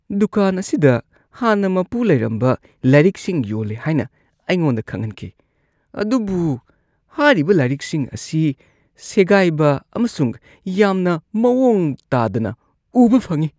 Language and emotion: Manipuri, disgusted